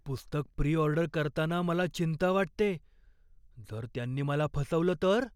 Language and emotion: Marathi, fearful